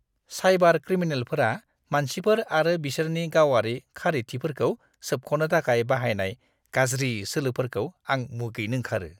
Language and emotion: Bodo, disgusted